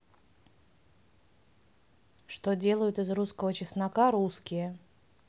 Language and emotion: Russian, neutral